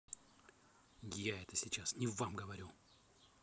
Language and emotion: Russian, angry